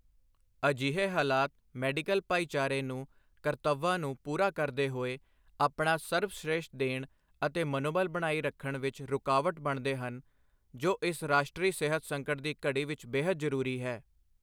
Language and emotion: Punjabi, neutral